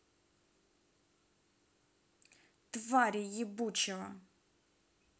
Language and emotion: Russian, angry